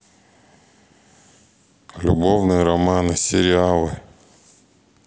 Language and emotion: Russian, neutral